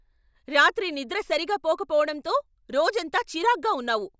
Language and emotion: Telugu, angry